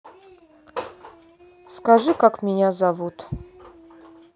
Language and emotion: Russian, neutral